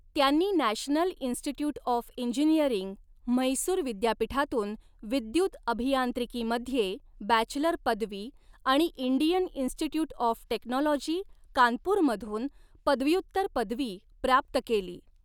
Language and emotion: Marathi, neutral